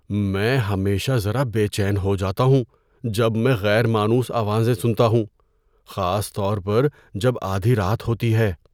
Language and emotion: Urdu, fearful